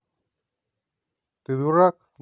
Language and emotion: Russian, angry